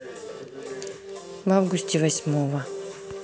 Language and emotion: Russian, neutral